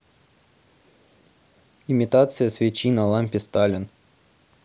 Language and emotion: Russian, neutral